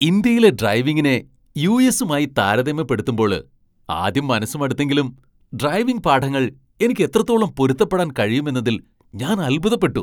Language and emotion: Malayalam, surprised